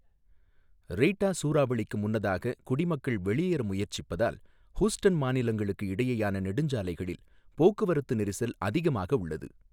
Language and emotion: Tamil, neutral